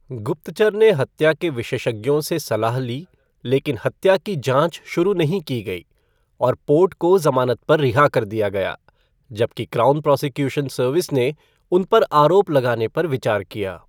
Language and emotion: Hindi, neutral